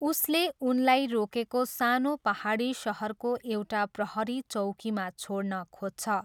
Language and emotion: Nepali, neutral